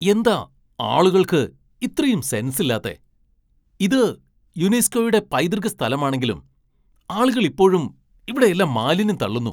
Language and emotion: Malayalam, angry